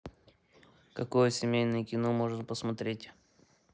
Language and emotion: Russian, neutral